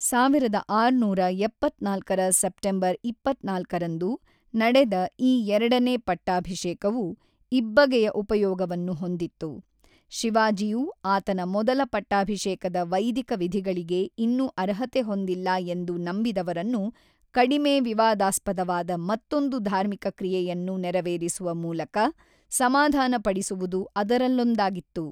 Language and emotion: Kannada, neutral